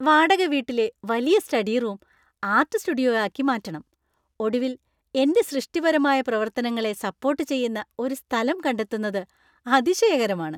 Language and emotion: Malayalam, happy